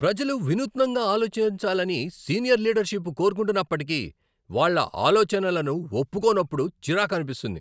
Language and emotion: Telugu, angry